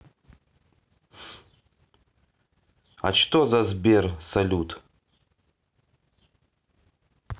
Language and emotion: Russian, neutral